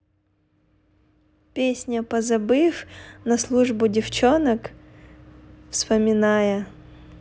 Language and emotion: Russian, neutral